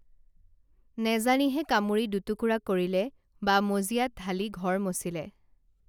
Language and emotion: Assamese, neutral